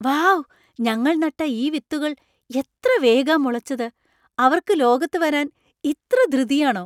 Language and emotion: Malayalam, surprised